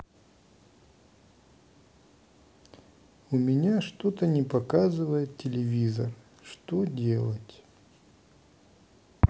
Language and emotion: Russian, sad